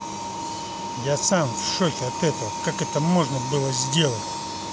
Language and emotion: Russian, angry